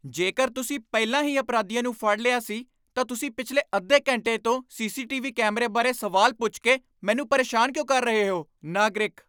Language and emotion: Punjabi, angry